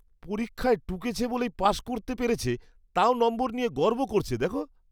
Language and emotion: Bengali, disgusted